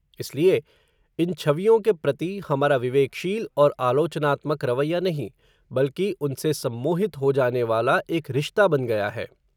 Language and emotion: Hindi, neutral